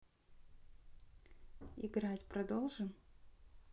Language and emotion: Russian, neutral